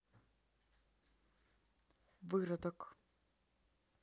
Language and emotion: Russian, neutral